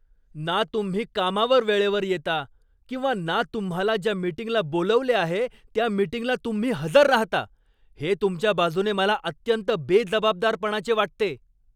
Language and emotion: Marathi, angry